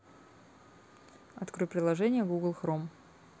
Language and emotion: Russian, neutral